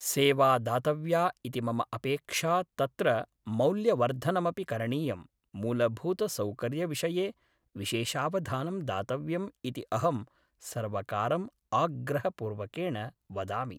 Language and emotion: Sanskrit, neutral